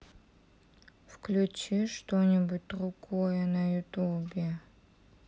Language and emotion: Russian, sad